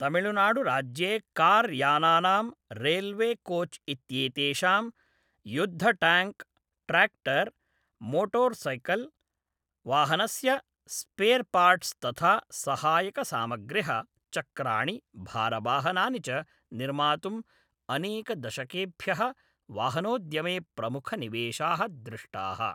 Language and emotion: Sanskrit, neutral